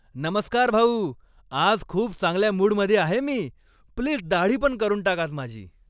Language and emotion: Marathi, happy